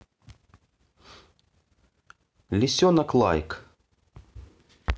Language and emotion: Russian, neutral